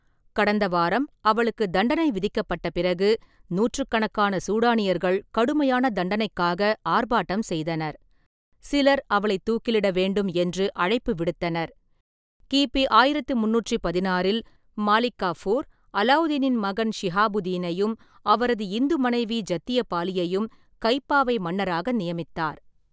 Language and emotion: Tamil, neutral